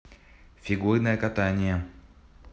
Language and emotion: Russian, neutral